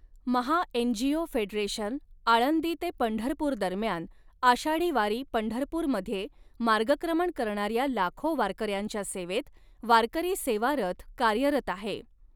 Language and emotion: Marathi, neutral